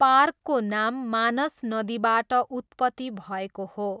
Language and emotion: Nepali, neutral